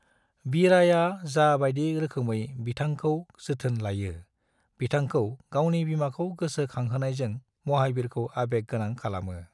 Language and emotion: Bodo, neutral